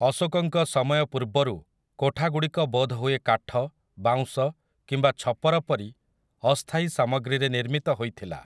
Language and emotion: Odia, neutral